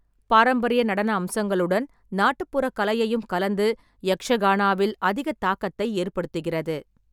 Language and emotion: Tamil, neutral